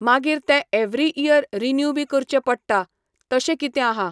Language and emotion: Goan Konkani, neutral